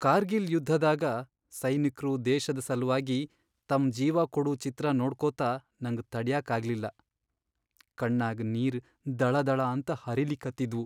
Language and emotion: Kannada, sad